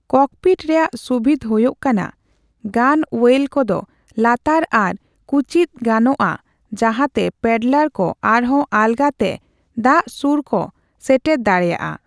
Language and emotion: Santali, neutral